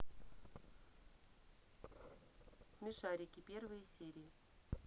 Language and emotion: Russian, neutral